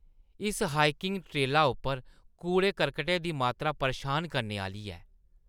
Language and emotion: Dogri, disgusted